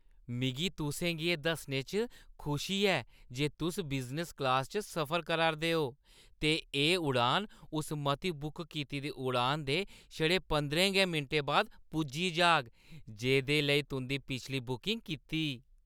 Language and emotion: Dogri, happy